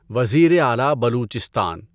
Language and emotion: Urdu, neutral